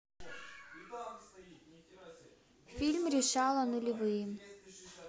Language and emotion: Russian, neutral